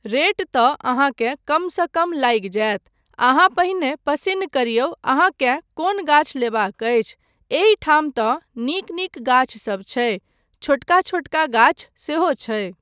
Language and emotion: Maithili, neutral